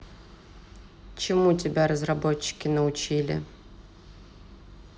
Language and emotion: Russian, neutral